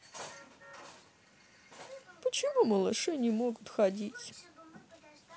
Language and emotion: Russian, neutral